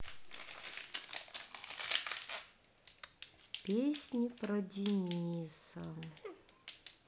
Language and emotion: Russian, sad